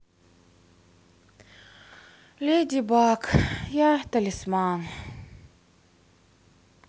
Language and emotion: Russian, sad